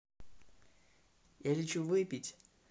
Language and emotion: Russian, neutral